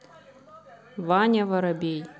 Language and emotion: Russian, neutral